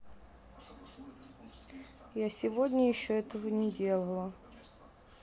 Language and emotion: Russian, neutral